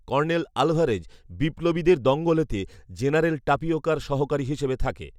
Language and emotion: Bengali, neutral